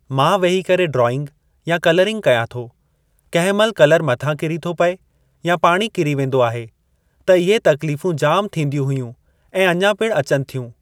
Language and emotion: Sindhi, neutral